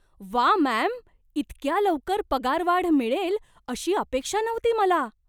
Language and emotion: Marathi, surprised